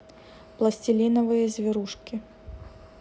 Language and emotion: Russian, neutral